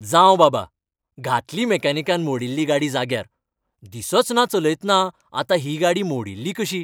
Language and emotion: Goan Konkani, happy